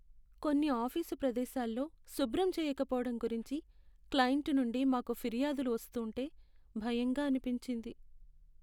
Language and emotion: Telugu, sad